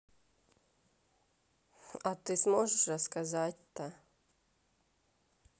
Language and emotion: Russian, neutral